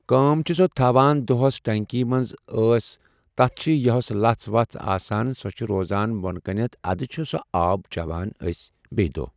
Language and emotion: Kashmiri, neutral